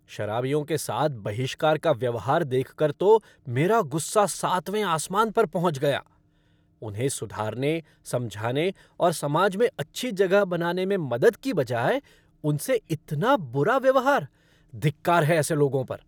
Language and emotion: Hindi, angry